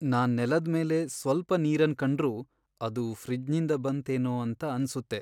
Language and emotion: Kannada, sad